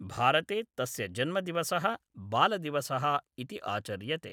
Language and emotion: Sanskrit, neutral